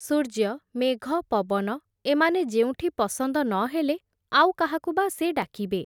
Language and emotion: Odia, neutral